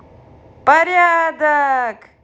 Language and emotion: Russian, positive